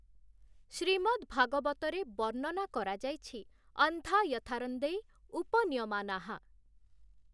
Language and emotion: Odia, neutral